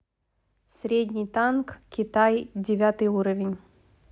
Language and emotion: Russian, neutral